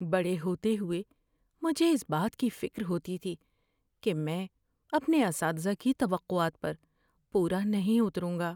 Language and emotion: Urdu, fearful